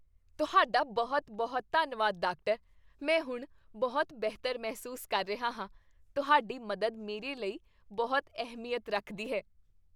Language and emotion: Punjabi, happy